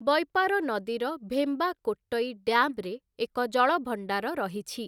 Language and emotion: Odia, neutral